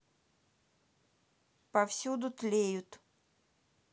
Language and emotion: Russian, neutral